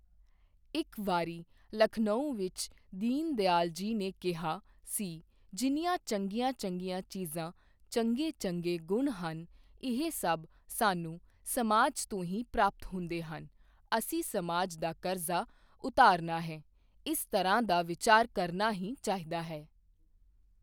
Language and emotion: Punjabi, neutral